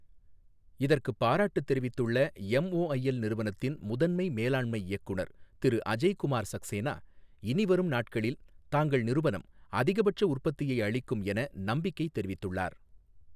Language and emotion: Tamil, neutral